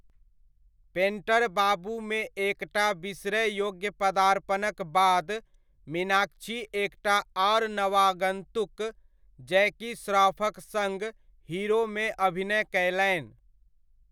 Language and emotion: Maithili, neutral